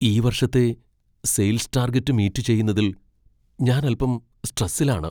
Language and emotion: Malayalam, fearful